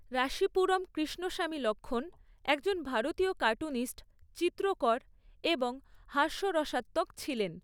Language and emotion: Bengali, neutral